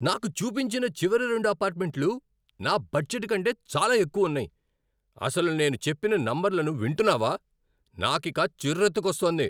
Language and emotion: Telugu, angry